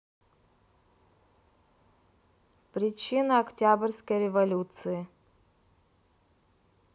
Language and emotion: Russian, neutral